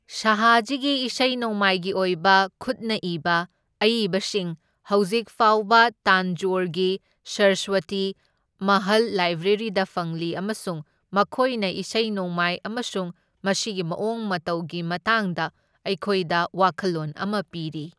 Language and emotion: Manipuri, neutral